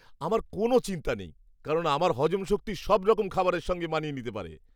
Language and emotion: Bengali, happy